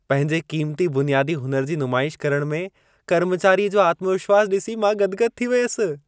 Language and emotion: Sindhi, happy